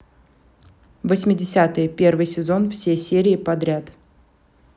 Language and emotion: Russian, neutral